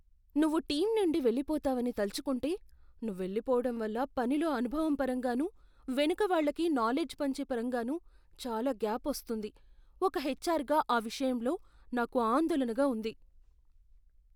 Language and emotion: Telugu, fearful